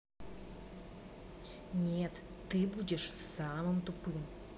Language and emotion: Russian, angry